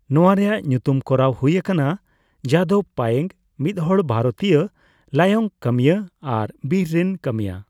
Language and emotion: Santali, neutral